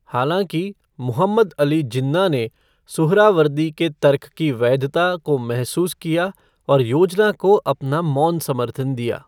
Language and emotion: Hindi, neutral